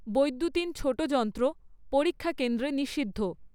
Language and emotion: Bengali, neutral